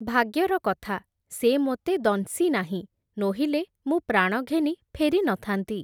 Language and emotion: Odia, neutral